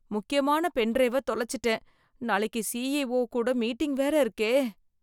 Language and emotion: Tamil, fearful